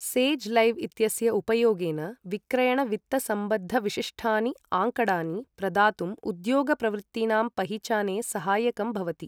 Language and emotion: Sanskrit, neutral